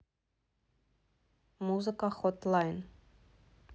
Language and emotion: Russian, neutral